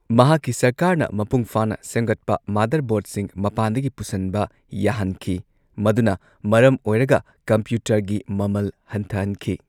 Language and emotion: Manipuri, neutral